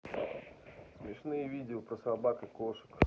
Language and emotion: Russian, neutral